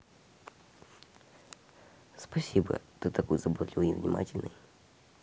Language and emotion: Russian, neutral